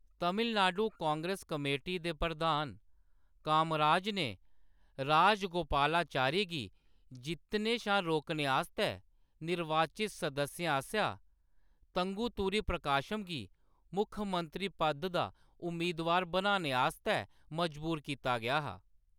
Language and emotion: Dogri, neutral